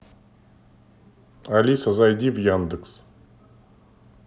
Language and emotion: Russian, neutral